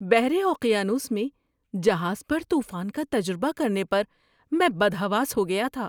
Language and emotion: Urdu, surprised